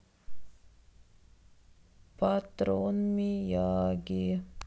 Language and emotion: Russian, sad